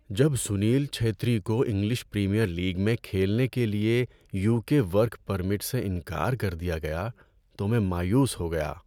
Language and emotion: Urdu, sad